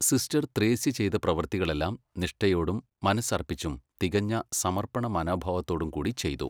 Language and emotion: Malayalam, neutral